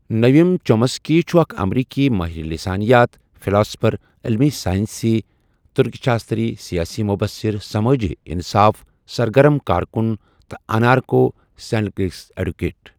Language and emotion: Kashmiri, neutral